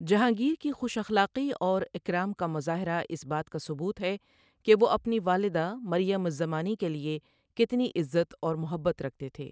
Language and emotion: Urdu, neutral